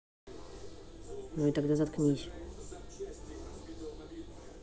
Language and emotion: Russian, angry